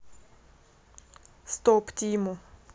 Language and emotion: Russian, neutral